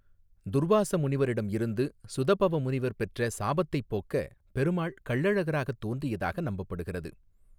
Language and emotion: Tamil, neutral